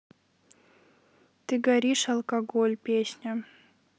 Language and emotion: Russian, neutral